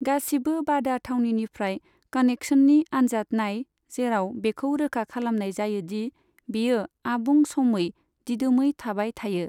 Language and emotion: Bodo, neutral